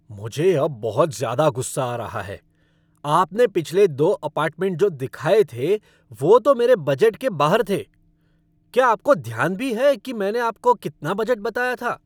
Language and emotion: Hindi, angry